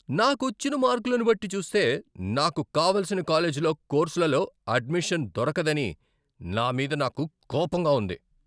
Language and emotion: Telugu, angry